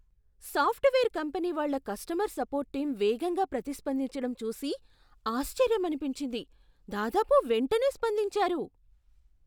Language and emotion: Telugu, surprised